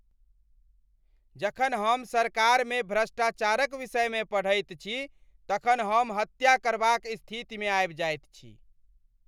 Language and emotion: Maithili, angry